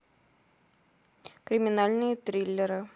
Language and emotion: Russian, neutral